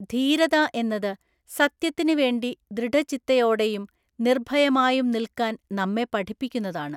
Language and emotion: Malayalam, neutral